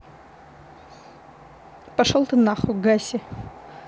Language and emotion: Russian, neutral